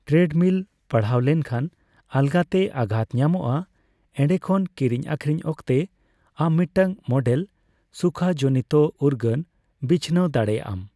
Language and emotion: Santali, neutral